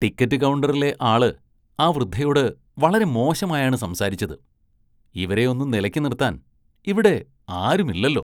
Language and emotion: Malayalam, disgusted